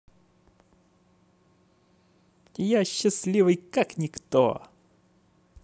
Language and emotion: Russian, positive